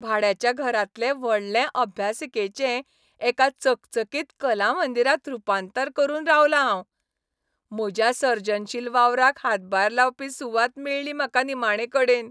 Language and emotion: Goan Konkani, happy